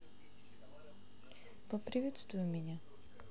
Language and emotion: Russian, neutral